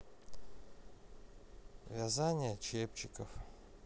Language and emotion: Russian, sad